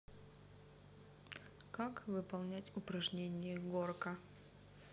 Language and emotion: Russian, neutral